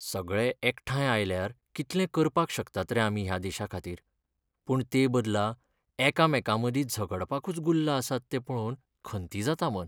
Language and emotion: Goan Konkani, sad